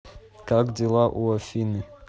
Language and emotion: Russian, neutral